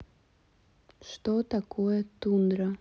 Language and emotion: Russian, neutral